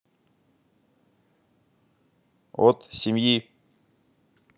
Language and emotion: Russian, neutral